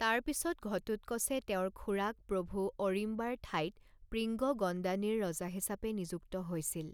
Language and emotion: Assamese, neutral